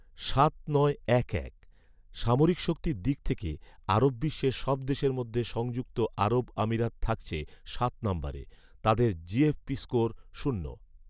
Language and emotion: Bengali, neutral